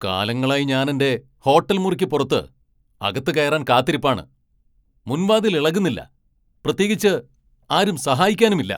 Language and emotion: Malayalam, angry